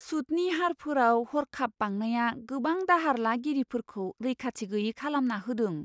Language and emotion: Bodo, surprised